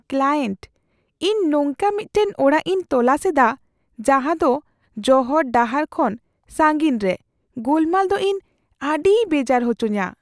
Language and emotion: Santali, fearful